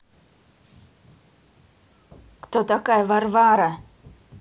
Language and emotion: Russian, angry